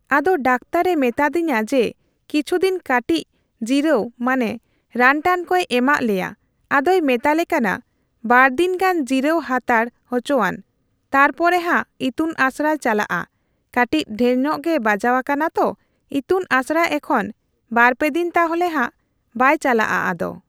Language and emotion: Santali, neutral